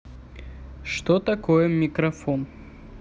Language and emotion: Russian, neutral